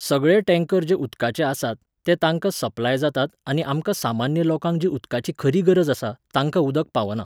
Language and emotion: Goan Konkani, neutral